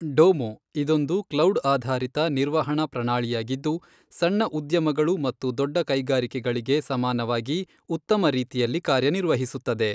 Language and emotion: Kannada, neutral